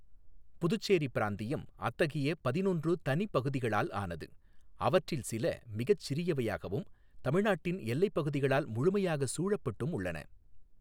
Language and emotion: Tamil, neutral